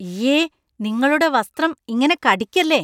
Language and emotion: Malayalam, disgusted